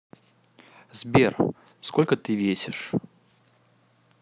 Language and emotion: Russian, neutral